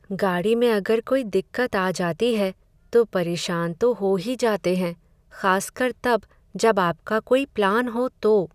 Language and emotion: Hindi, sad